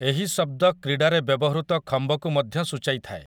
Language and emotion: Odia, neutral